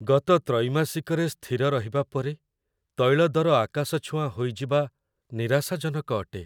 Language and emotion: Odia, sad